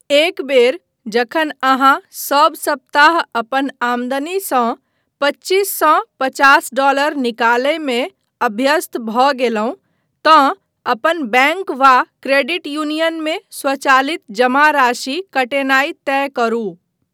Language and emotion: Maithili, neutral